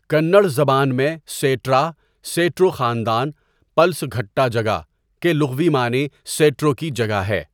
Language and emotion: Urdu, neutral